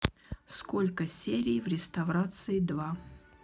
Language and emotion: Russian, neutral